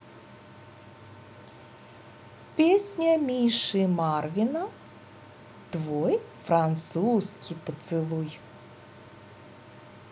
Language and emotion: Russian, positive